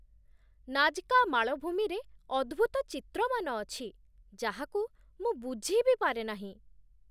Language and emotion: Odia, surprised